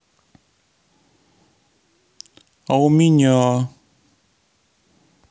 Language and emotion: Russian, sad